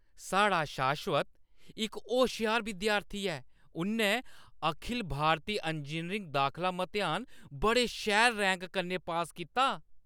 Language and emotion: Dogri, happy